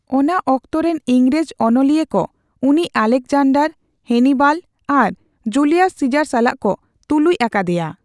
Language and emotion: Santali, neutral